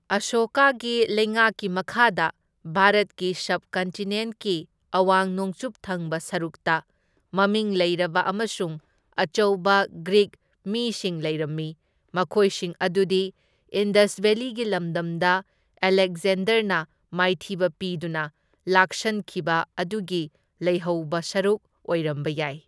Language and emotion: Manipuri, neutral